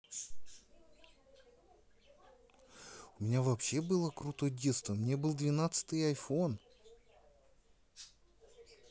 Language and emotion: Russian, neutral